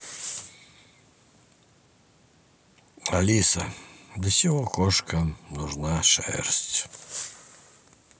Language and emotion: Russian, neutral